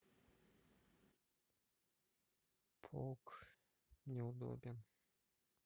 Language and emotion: Russian, sad